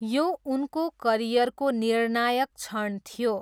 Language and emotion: Nepali, neutral